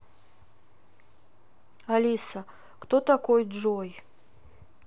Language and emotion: Russian, sad